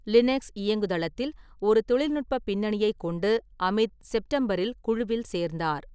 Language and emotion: Tamil, neutral